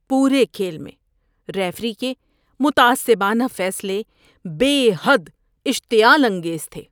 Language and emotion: Urdu, disgusted